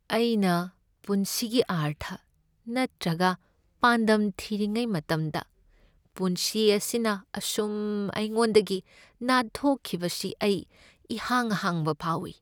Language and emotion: Manipuri, sad